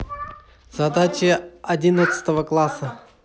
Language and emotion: Russian, neutral